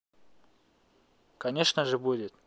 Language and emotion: Russian, neutral